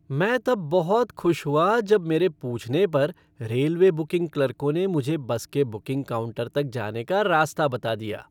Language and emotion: Hindi, happy